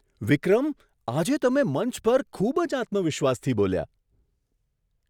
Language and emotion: Gujarati, surprised